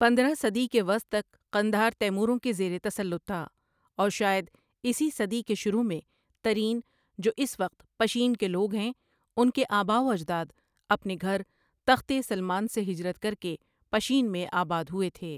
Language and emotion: Urdu, neutral